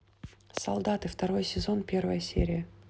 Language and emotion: Russian, neutral